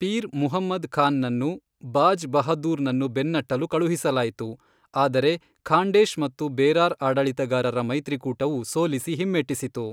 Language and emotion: Kannada, neutral